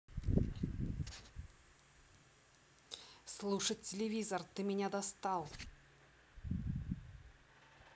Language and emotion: Russian, angry